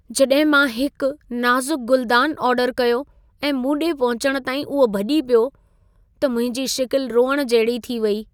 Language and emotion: Sindhi, sad